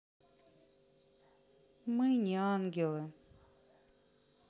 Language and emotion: Russian, sad